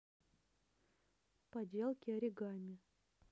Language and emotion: Russian, neutral